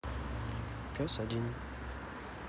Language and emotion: Russian, neutral